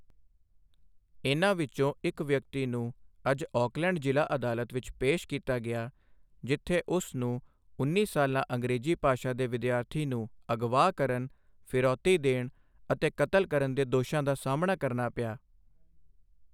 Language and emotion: Punjabi, neutral